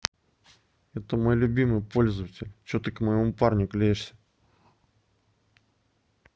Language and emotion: Russian, angry